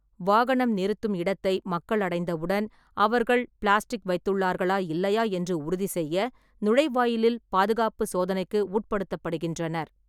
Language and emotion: Tamil, neutral